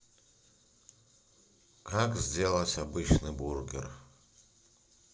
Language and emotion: Russian, neutral